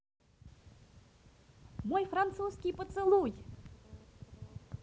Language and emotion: Russian, positive